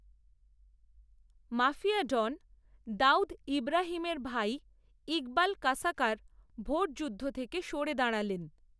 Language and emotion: Bengali, neutral